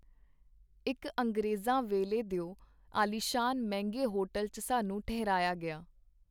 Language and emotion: Punjabi, neutral